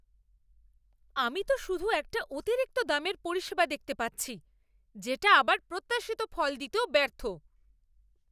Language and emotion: Bengali, angry